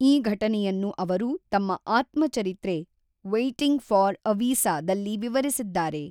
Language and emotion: Kannada, neutral